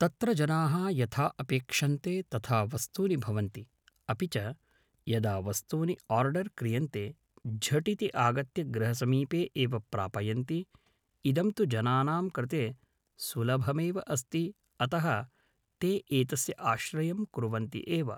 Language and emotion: Sanskrit, neutral